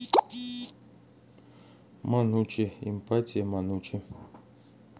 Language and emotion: Russian, neutral